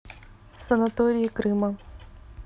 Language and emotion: Russian, neutral